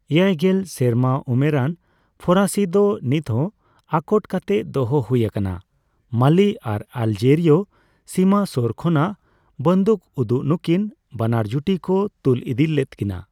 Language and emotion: Santali, neutral